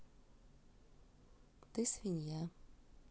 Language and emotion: Russian, neutral